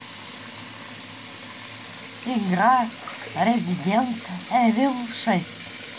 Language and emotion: Russian, neutral